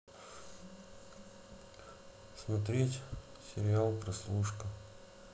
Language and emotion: Russian, neutral